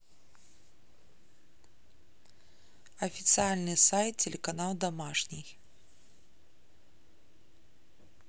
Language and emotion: Russian, neutral